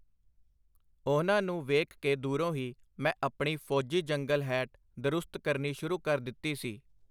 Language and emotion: Punjabi, neutral